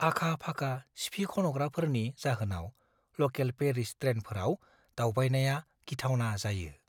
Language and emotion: Bodo, fearful